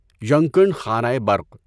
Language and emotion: Urdu, neutral